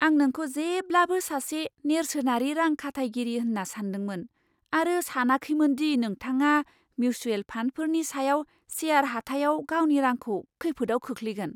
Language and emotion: Bodo, surprised